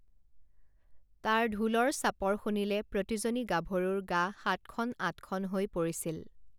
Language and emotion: Assamese, neutral